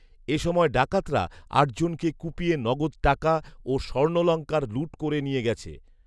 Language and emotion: Bengali, neutral